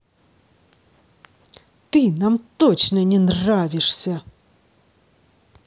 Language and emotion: Russian, angry